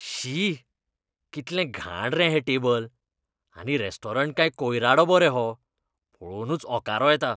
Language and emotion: Goan Konkani, disgusted